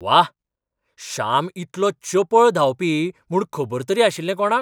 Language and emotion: Goan Konkani, surprised